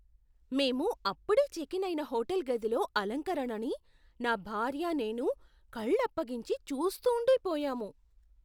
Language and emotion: Telugu, surprised